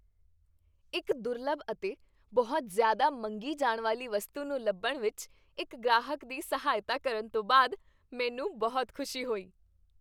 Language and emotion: Punjabi, happy